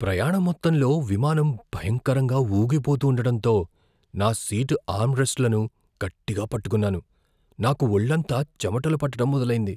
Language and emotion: Telugu, fearful